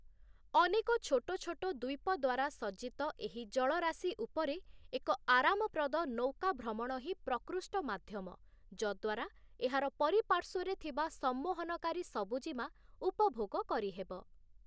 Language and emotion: Odia, neutral